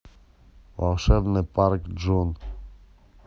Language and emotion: Russian, neutral